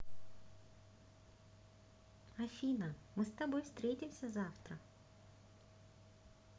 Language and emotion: Russian, positive